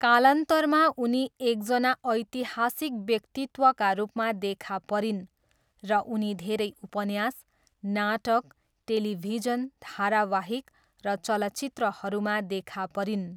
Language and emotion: Nepali, neutral